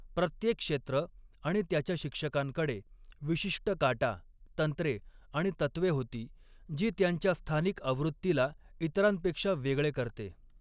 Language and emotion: Marathi, neutral